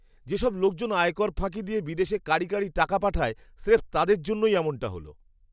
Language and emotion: Bengali, disgusted